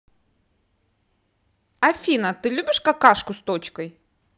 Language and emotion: Russian, positive